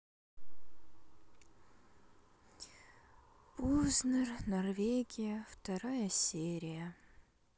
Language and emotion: Russian, sad